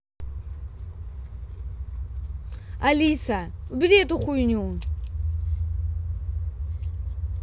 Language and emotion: Russian, angry